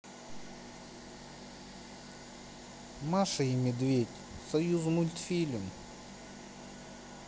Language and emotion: Russian, sad